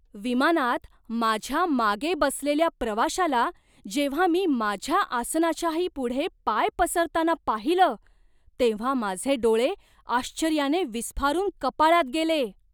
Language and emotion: Marathi, surprised